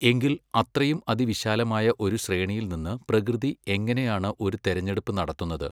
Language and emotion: Malayalam, neutral